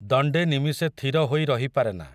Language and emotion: Odia, neutral